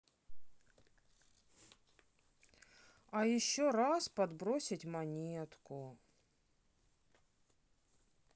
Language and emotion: Russian, sad